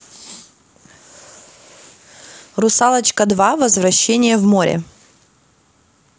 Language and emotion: Russian, neutral